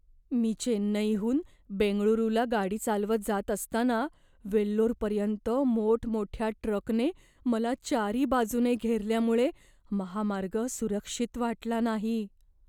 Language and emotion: Marathi, fearful